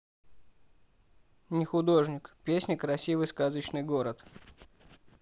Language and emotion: Russian, neutral